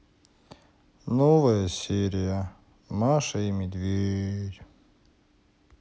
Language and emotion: Russian, sad